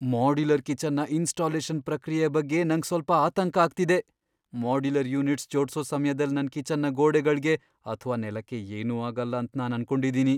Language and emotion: Kannada, fearful